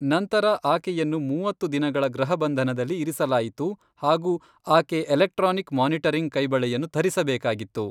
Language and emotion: Kannada, neutral